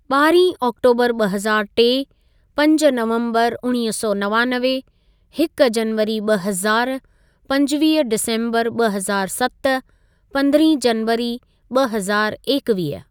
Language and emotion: Sindhi, neutral